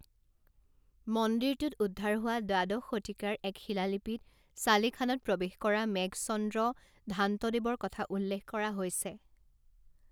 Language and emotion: Assamese, neutral